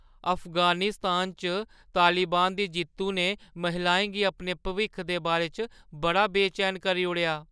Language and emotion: Dogri, fearful